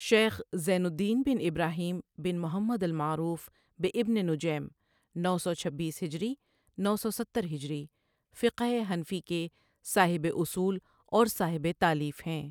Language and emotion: Urdu, neutral